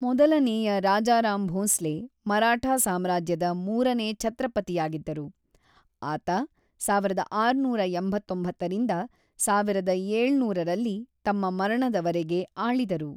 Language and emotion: Kannada, neutral